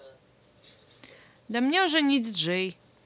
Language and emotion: Russian, neutral